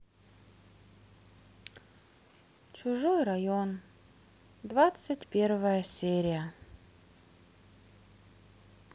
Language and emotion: Russian, sad